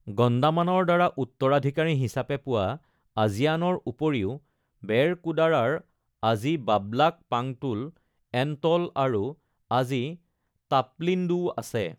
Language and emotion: Assamese, neutral